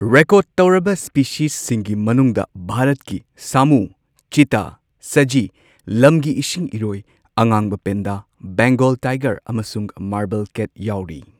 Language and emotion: Manipuri, neutral